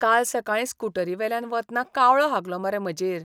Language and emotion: Goan Konkani, disgusted